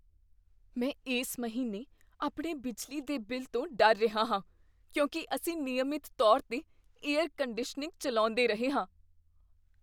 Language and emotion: Punjabi, fearful